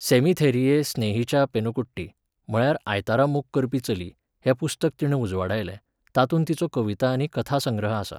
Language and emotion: Goan Konkani, neutral